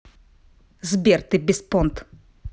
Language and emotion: Russian, angry